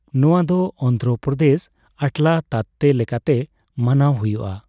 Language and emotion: Santali, neutral